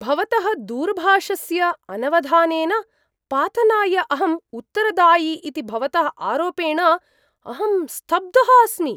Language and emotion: Sanskrit, surprised